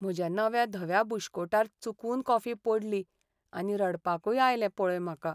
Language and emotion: Goan Konkani, sad